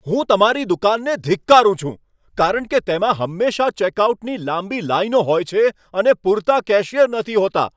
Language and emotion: Gujarati, angry